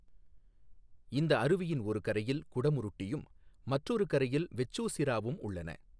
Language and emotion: Tamil, neutral